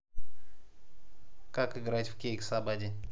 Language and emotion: Russian, neutral